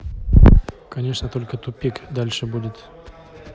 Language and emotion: Russian, neutral